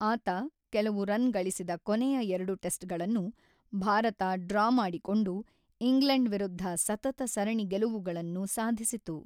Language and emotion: Kannada, neutral